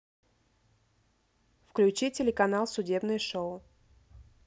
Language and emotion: Russian, neutral